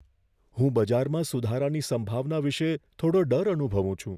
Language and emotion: Gujarati, fearful